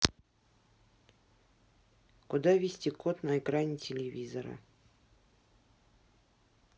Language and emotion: Russian, neutral